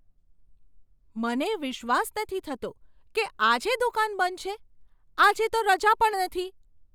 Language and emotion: Gujarati, surprised